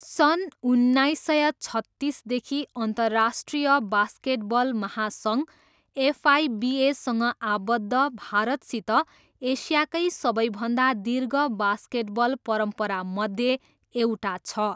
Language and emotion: Nepali, neutral